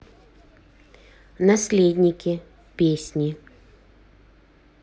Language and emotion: Russian, neutral